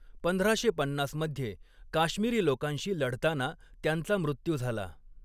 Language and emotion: Marathi, neutral